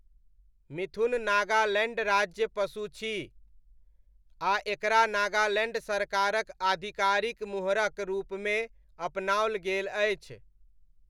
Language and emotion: Maithili, neutral